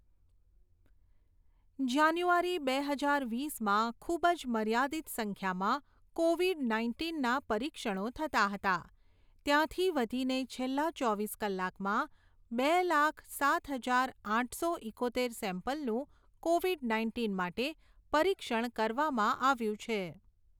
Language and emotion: Gujarati, neutral